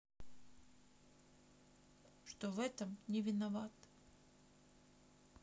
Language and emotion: Russian, sad